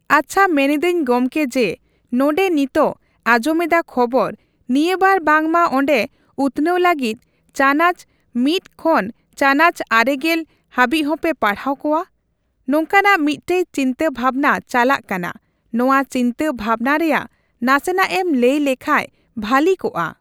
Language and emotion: Santali, neutral